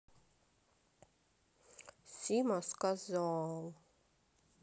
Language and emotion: Russian, sad